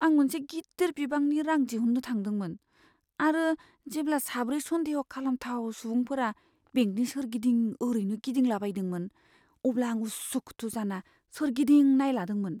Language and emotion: Bodo, fearful